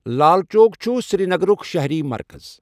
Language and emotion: Kashmiri, neutral